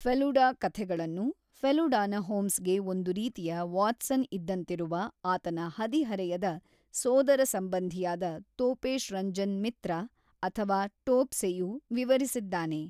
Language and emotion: Kannada, neutral